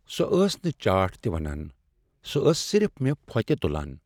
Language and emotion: Kashmiri, sad